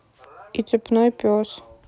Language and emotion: Russian, neutral